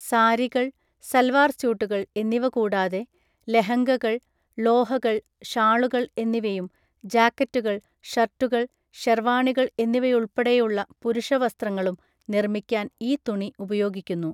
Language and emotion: Malayalam, neutral